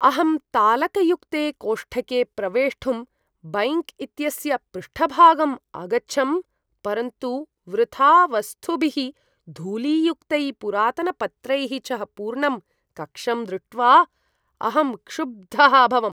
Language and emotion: Sanskrit, disgusted